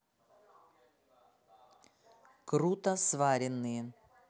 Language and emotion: Russian, neutral